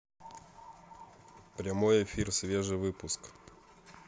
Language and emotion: Russian, neutral